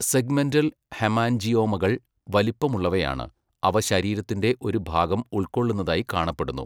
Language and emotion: Malayalam, neutral